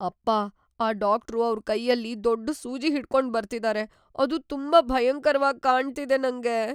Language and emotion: Kannada, fearful